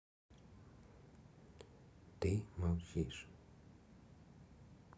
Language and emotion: Russian, neutral